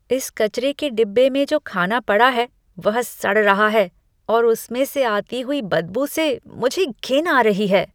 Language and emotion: Hindi, disgusted